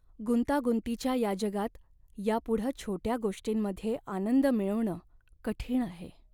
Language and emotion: Marathi, sad